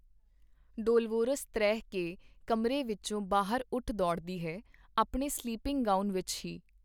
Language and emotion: Punjabi, neutral